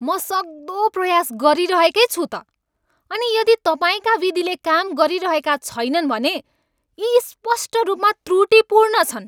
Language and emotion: Nepali, angry